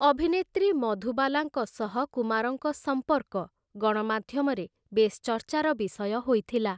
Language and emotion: Odia, neutral